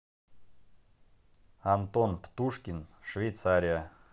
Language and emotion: Russian, neutral